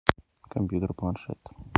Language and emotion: Russian, neutral